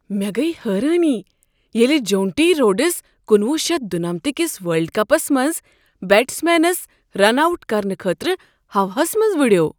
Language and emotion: Kashmiri, surprised